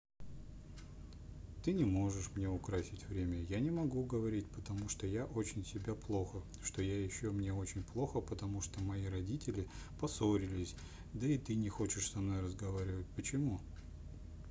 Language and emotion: Russian, sad